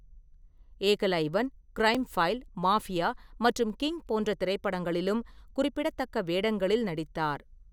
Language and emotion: Tamil, neutral